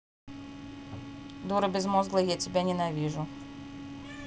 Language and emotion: Russian, angry